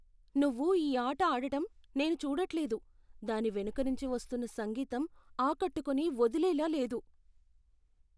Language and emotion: Telugu, fearful